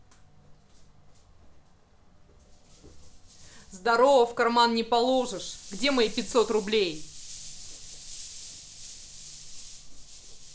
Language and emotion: Russian, angry